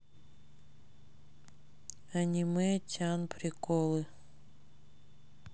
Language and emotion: Russian, sad